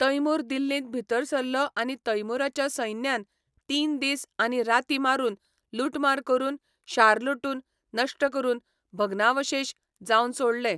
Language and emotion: Goan Konkani, neutral